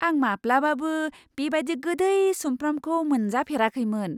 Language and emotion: Bodo, surprised